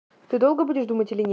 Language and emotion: Russian, angry